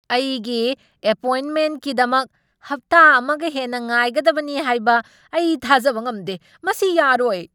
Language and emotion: Manipuri, angry